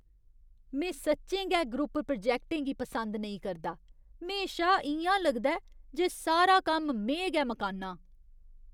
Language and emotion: Dogri, disgusted